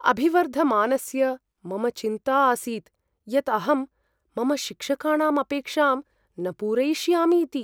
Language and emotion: Sanskrit, fearful